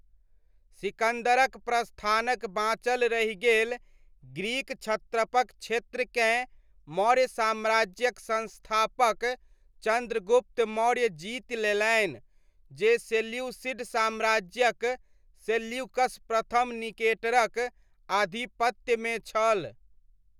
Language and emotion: Maithili, neutral